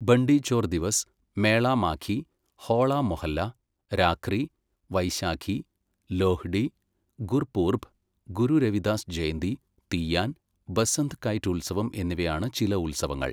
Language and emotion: Malayalam, neutral